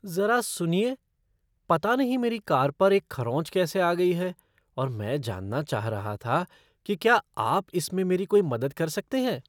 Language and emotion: Hindi, surprised